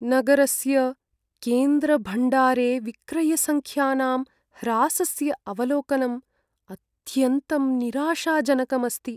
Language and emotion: Sanskrit, sad